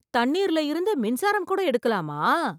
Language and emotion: Tamil, surprised